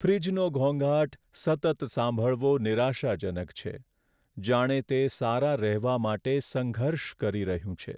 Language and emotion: Gujarati, sad